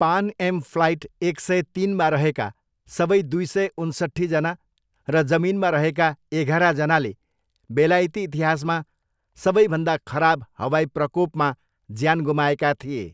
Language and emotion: Nepali, neutral